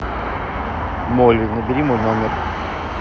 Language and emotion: Russian, neutral